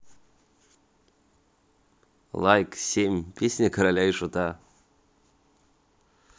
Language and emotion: Russian, neutral